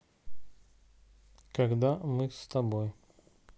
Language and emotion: Russian, neutral